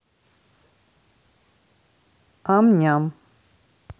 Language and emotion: Russian, neutral